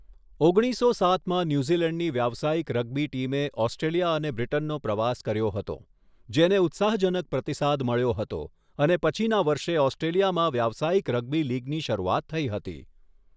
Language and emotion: Gujarati, neutral